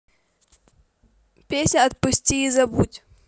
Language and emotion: Russian, positive